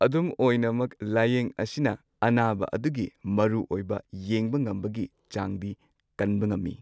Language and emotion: Manipuri, neutral